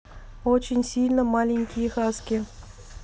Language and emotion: Russian, neutral